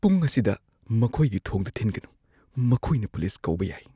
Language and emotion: Manipuri, fearful